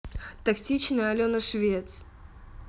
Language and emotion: Russian, neutral